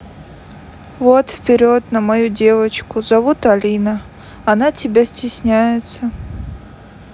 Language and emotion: Russian, neutral